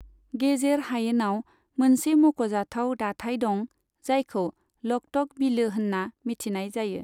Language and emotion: Bodo, neutral